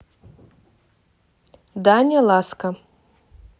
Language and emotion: Russian, neutral